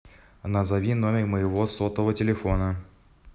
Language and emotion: Russian, neutral